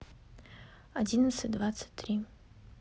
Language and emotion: Russian, neutral